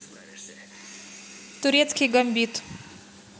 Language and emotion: Russian, neutral